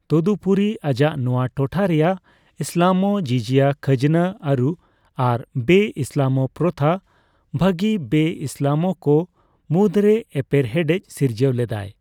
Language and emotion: Santali, neutral